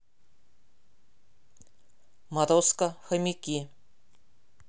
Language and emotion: Russian, neutral